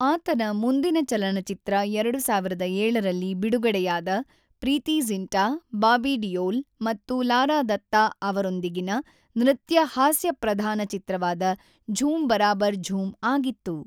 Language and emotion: Kannada, neutral